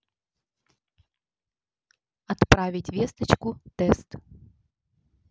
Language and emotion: Russian, neutral